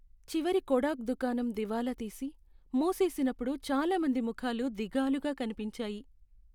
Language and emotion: Telugu, sad